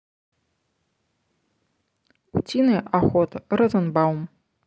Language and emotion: Russian, neutral